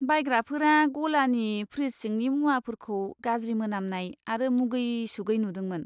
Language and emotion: Bodo, disgusted